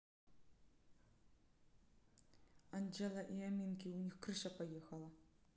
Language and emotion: Russian, neutral